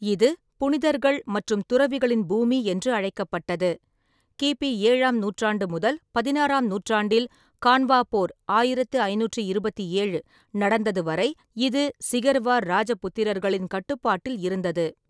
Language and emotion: Tamil, neutral